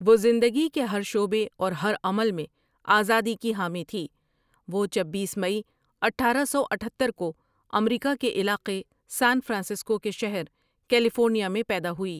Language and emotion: Urdu, neutral